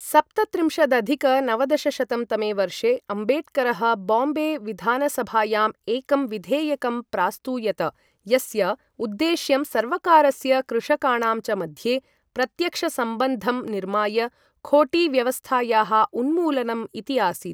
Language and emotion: Sanskrit, neutral